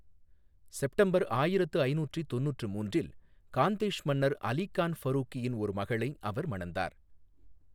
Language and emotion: Tamil, neutral